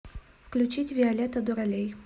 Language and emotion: Russian, neutral